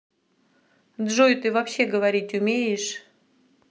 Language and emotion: Russian, neutral